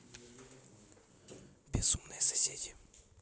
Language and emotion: Russian, neutral